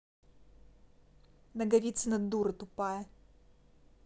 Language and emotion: Russian, angry